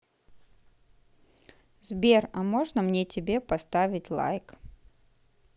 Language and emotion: Russian, neutral